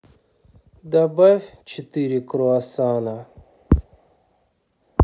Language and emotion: Russian, sad